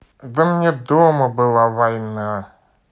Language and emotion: Russian, neutral